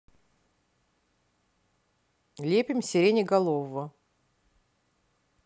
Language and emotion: Russian, neutral